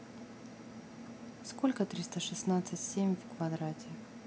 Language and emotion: Russian, neutral